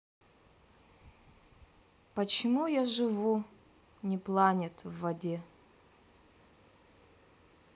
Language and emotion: Russian, sad